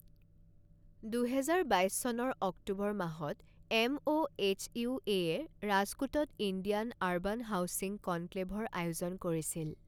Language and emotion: Assamese, neutral